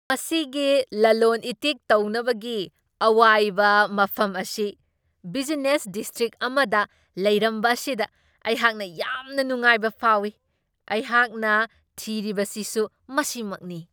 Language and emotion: Manipuri, surprised